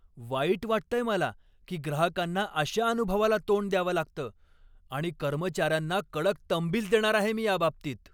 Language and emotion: Marathi, angry